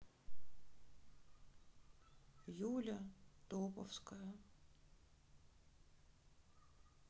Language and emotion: Russian, sad